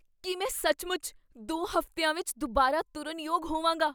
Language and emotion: Punjabi, surprised